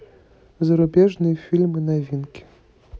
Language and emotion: Russian, neutral